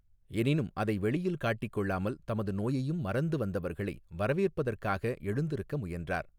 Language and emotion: Tamil, neutral